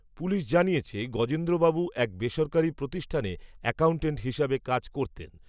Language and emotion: Bengali, neutral